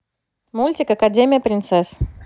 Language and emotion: Russian, positive